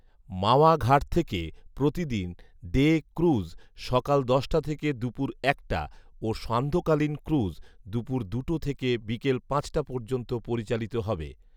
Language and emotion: Bengali, neutral